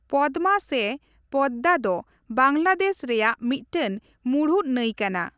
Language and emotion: Santali, neutral